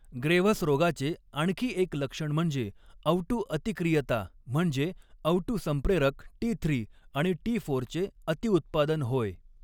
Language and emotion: Marathi, neutral